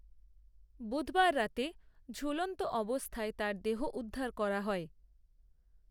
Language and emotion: Bengali, neutral